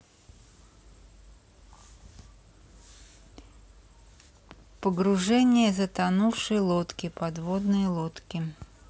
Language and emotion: Russian, neutral